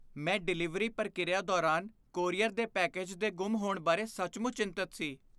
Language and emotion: Punjabi, fearful